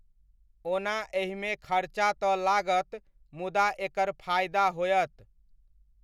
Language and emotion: Maithili, neutral